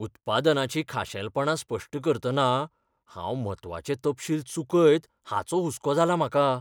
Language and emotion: Goan Konkani, fearful